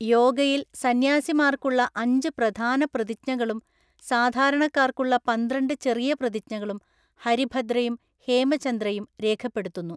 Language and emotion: Malayalam, neutral